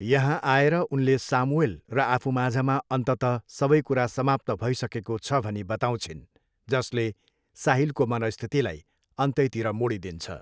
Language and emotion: Nepali, neutral